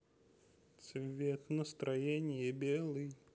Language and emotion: Russian, positive